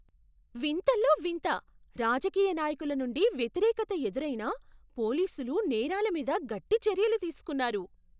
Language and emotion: Telugu, surprised